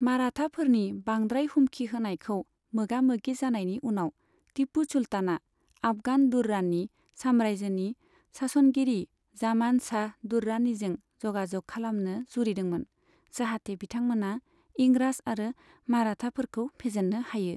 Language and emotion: Bodo, neutral